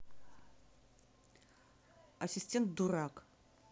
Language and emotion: Russian, angry